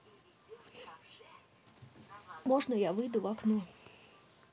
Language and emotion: Russian, sad